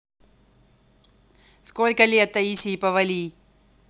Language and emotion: Russian, neutral